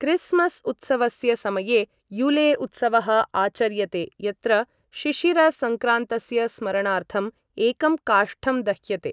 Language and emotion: Sanskrit, neutral